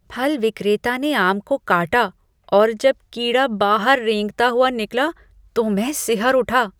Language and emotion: Hindi, disgusted